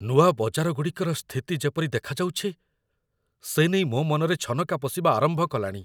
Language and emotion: Odia, fearful